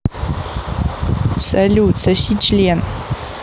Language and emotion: Russian, neutral